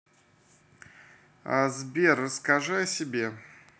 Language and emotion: Russian, neutral